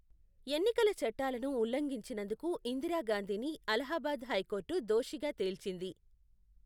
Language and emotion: Telugu, neutral